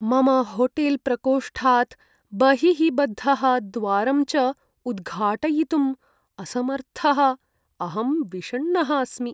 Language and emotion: Sanskrit, sad